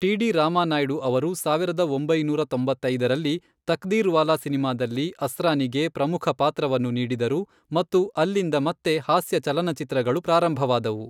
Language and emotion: Kannada, neutral